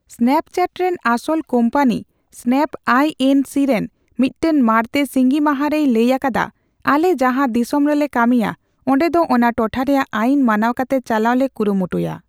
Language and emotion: Santali, neutral